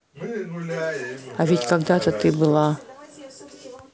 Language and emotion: Russian, neutral